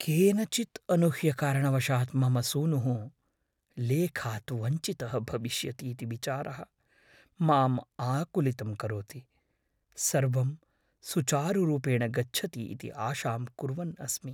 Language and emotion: Sanskrit, fearful